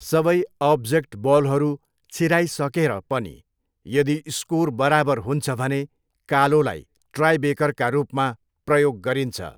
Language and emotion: Nepali, neutral